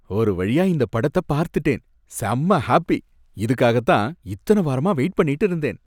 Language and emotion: Tamil, happy